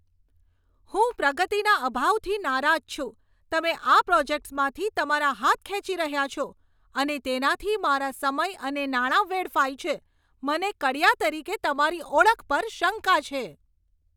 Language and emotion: Gujarati, angry